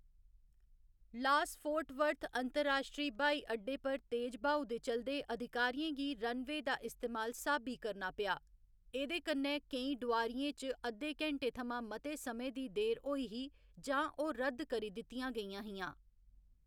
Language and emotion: Dogri, neutral